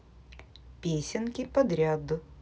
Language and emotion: Russian, positive